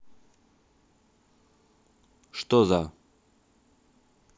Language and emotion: Russian, neutral